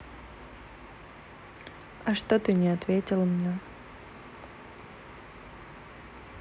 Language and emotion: Russian, neutral